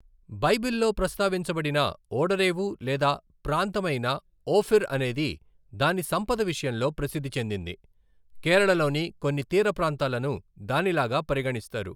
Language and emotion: Telugu, neutral